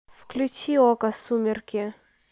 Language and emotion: Russian, neutral